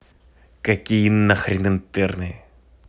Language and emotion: Russian, angry